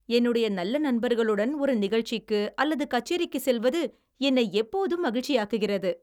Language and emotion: Tamil, happy